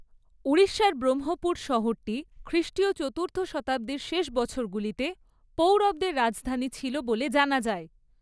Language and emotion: Bengali, neutral